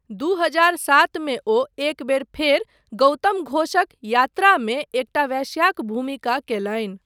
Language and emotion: Maithili, neutral